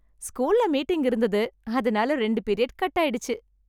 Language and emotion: Tamil, happy